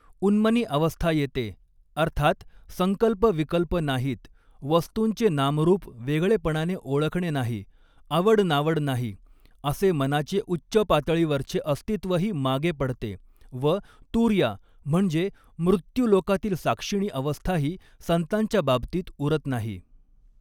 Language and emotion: Marathi, neutral